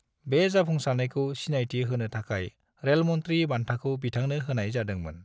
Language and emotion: Bodo, neutral